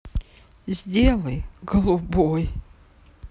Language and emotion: Russian, sad